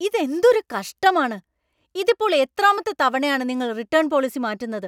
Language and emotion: Malayalam, angry